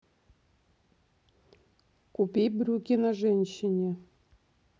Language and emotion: Russian, neutral